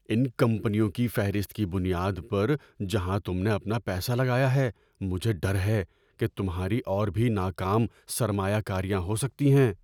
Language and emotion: Urdu, fearful